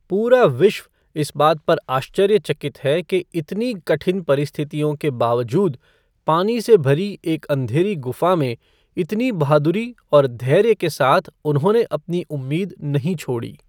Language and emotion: Hindi, neutral